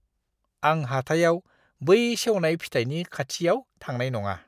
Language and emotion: Bodo, disgusted